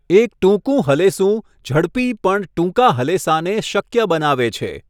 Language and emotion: Gujarati, neutral